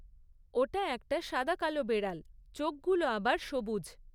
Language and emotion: Bengali, neutral